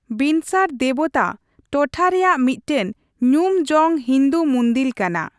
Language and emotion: Santali, neutral